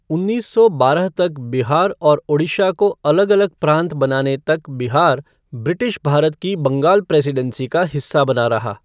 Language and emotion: Hindi, neutral